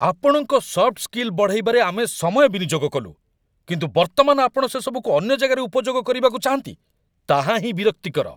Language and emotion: Odia, angry